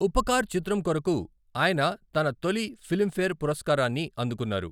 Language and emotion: Telugu, neutral